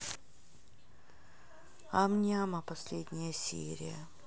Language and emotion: Russian, neutral